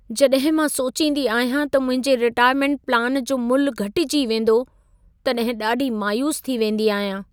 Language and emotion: Sindhi, sad